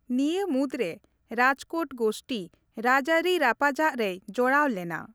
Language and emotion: Santali, neutral